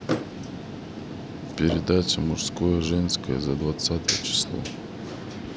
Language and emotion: Russian, neutral